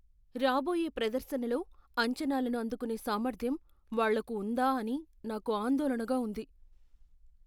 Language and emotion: Telugu, fearful